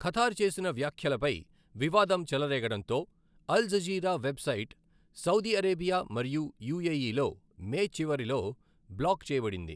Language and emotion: Telugu, neutral